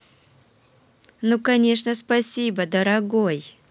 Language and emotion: Russian, positive